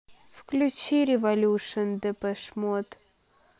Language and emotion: Russian, sad